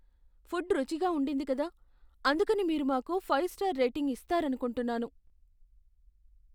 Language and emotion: Telugu, fearful